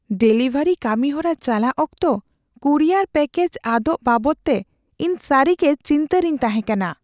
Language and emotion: Santali, fearful